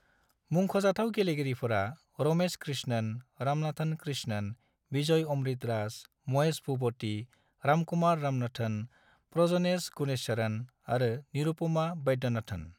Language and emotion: Bodo, neutral